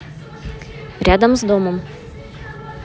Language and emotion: Russian, neutral